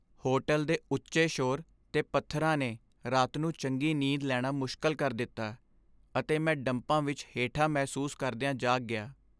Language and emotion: Punjabi, sad